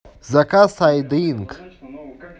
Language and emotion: Russian, positive